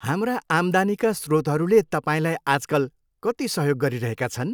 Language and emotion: Nepali, happy